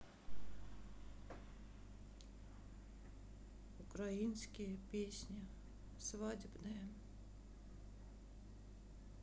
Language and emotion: Russian, sad